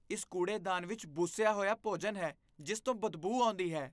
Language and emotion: Punjabi, disgusted